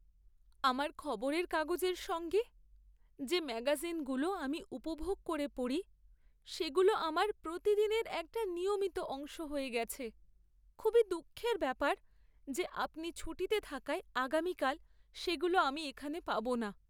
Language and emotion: Bengali, sad